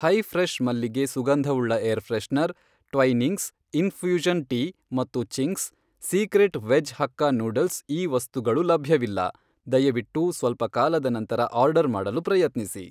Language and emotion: Kannada, neutral